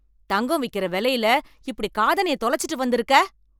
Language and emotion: Tamil, angry